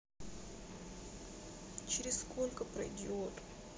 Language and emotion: Russian, sad